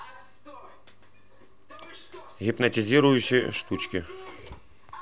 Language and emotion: Russian, neutral